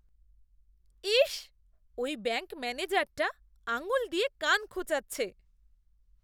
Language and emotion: Bengali, disgusted